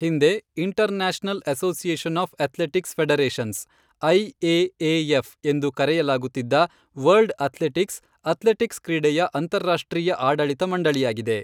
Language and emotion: Kannada, neutral